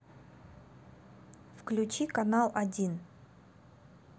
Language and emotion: Russian, neutral